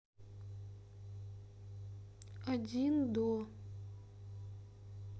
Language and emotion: Russian, neutral